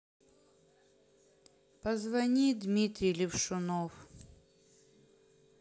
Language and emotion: Russian, sad